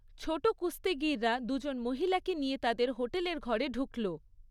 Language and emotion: Bengali, neutral